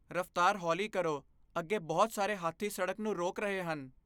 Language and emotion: Punjabi, fearful